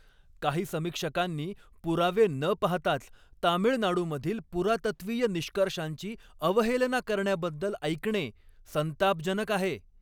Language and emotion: Marathi, angry